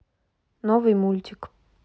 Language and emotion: Russian, neutral